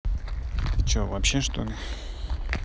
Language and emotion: Russian, neutral